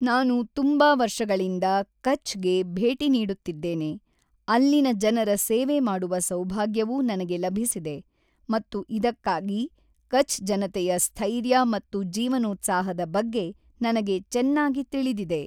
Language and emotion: Kannada, neutral